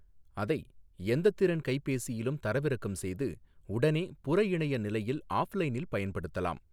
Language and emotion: Tamil, neutral